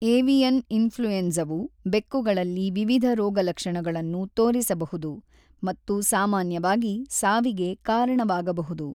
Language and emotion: Kannada, neutral